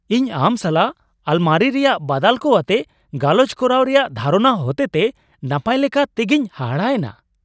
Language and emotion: Santali, surprised